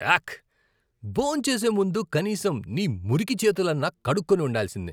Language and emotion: Telugu, disgusted